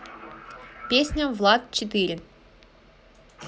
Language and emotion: Russian, positive